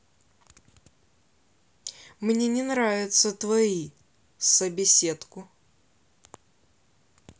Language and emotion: Russian, angry